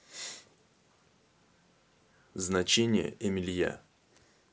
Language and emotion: Russian, neutral